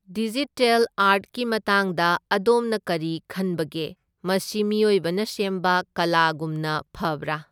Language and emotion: Manipuri, neutral